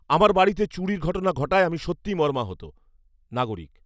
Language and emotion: Bengali, angry